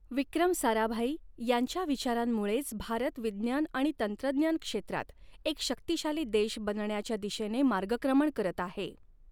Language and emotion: Marathi, neutral